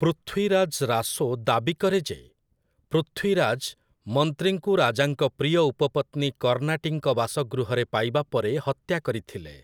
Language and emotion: Odia, neutral